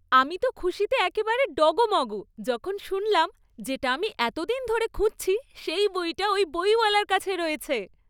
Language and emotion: Bengali, happy